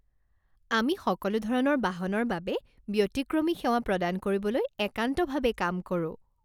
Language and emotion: Assamese, happy